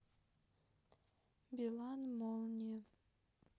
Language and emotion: Russian, sad